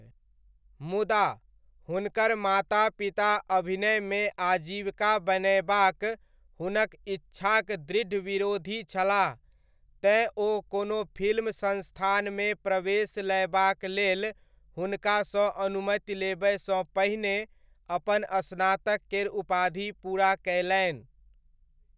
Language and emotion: Maithili, neutral